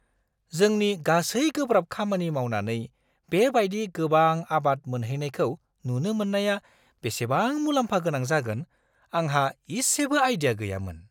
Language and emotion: Bodo, surprised